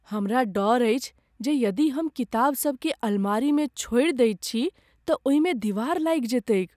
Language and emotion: Maithili, fearful